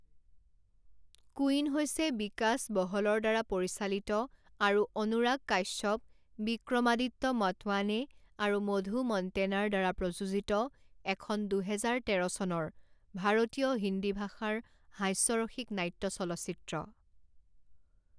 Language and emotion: Assamese, neutral